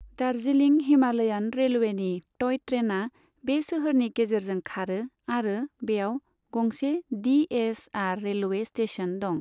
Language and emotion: Bodo, neutral